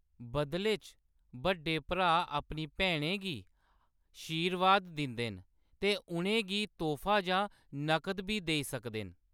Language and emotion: Dogri, neutral